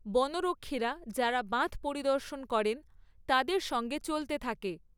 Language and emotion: Bengali, neutral